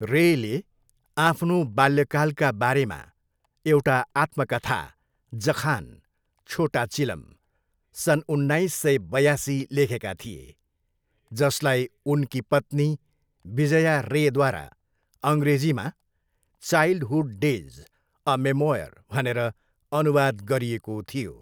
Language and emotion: Nepali, neutral